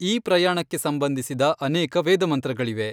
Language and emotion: Kannada, neutral